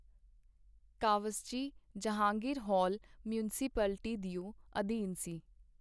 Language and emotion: Punjabi, neutral